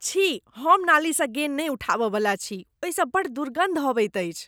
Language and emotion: Maithili, disgusted